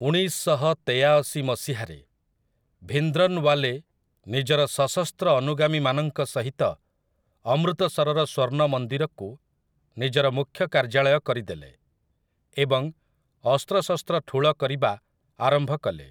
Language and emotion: Odia, neutral